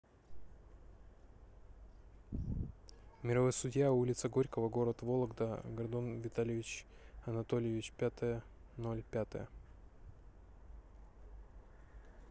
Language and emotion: Russian, neutral